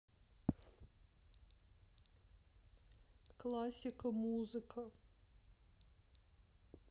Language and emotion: Russian, sad